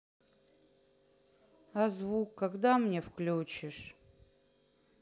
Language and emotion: Russian, sad